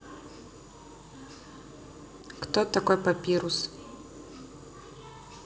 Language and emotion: Russian, neutral